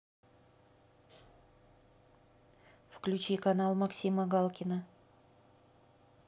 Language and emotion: Russian, neutral